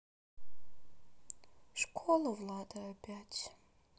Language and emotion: Russian, sad